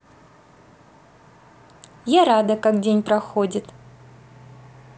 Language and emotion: Russian, positive